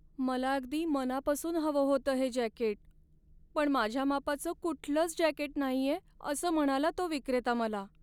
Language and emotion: Marathi, sad